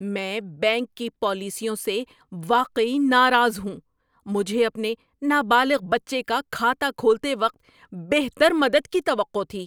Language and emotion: Urdu, angry